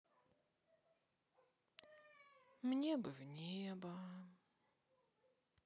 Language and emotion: Russian, sad